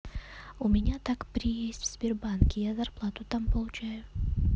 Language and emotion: Russian, neutral